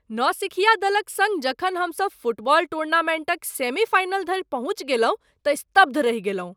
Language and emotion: Maithili, surprised